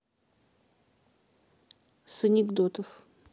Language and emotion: Russian, neutral